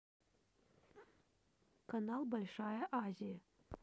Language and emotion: Russian, neutral